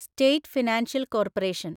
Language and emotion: Malayalam, neutral